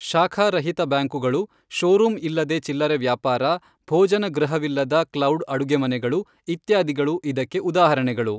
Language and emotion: Kannada, neutral